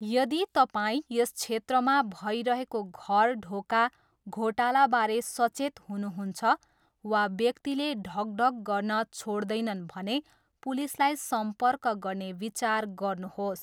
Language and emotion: Nepali, neutral